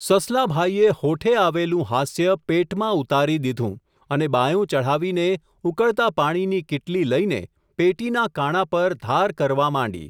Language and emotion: Gujarati, neutral